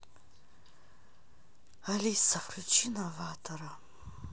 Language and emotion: Russian, sad